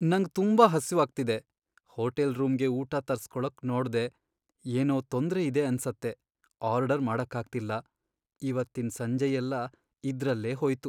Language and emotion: Kannada, sad